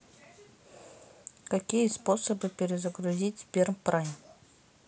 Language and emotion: Russian, neutral